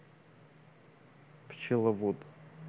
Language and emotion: Russian, neutral